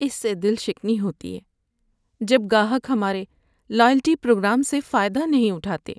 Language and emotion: Urdu, sad